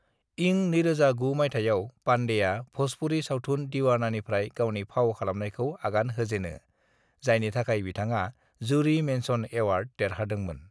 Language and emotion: Bodo, neutral